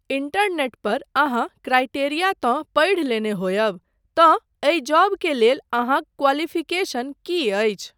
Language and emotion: Maithili, neutral